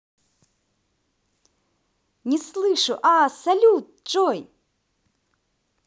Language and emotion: Russian, positive